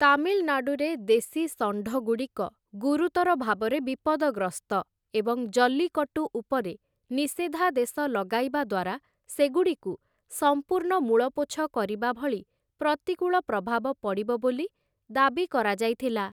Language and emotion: Odia, neutral